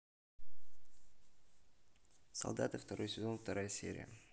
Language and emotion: Russian, neutral